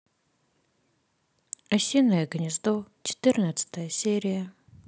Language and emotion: Russian, sad